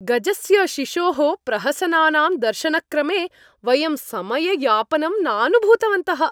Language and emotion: Sanskrit, happy